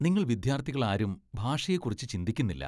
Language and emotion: Malayalam, disgusted